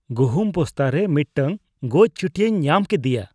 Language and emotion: Santali, disgusted